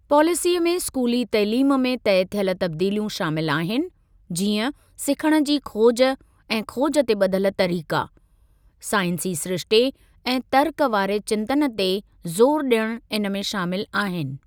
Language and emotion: Sindhi, neutral